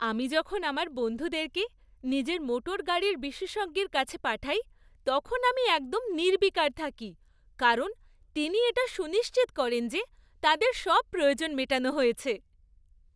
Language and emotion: Bengali, happy